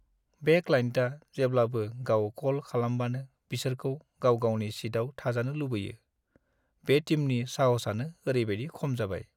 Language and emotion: Bodo, sad